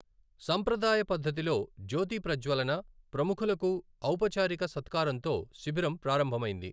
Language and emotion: Telugu, neutral